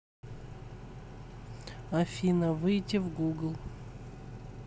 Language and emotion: Russian, neutral